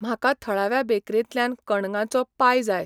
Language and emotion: Goan Konkani, neutral